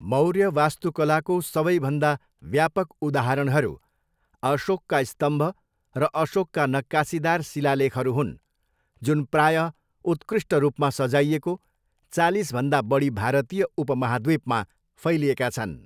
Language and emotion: Nepali, neutral